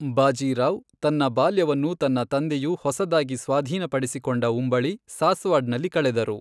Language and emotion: Kannada, neutral